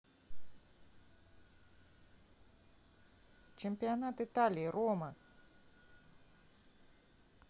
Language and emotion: Russian, neutral